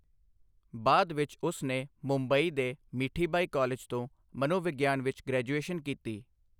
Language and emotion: Punjabi, neutral